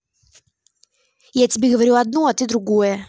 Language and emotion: Russian, angry